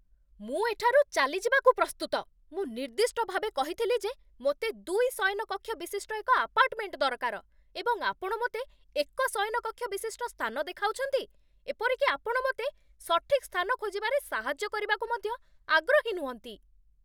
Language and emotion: Odia, angry